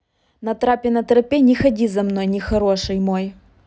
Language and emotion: Russian, neutral